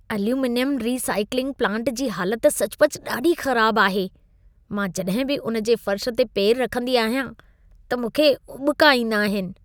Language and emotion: Sindhi, disgusted